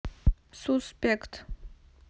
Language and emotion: Russian, neutral